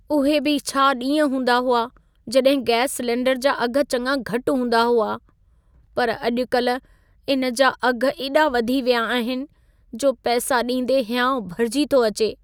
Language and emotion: Sindhi, sad